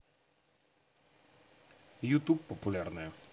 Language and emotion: Russian, neutral